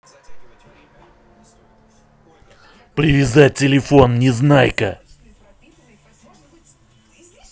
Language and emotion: Russian, angry